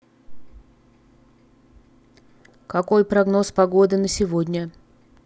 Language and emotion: Russian, neutral